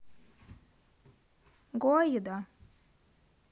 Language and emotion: Russian, neutral